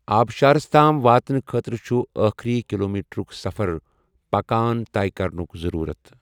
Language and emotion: Kashmiri, neutral